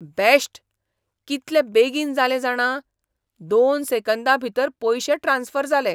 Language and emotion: Goan Konkani, surprised